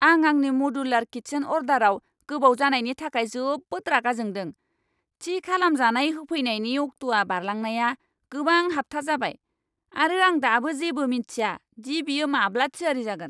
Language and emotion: Bodo, angry